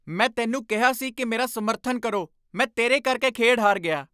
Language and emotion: Punjabi, angry